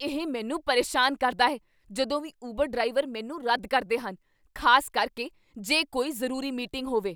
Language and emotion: Punjabi, angry